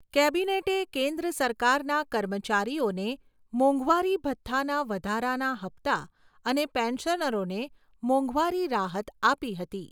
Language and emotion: Gujarati, neutral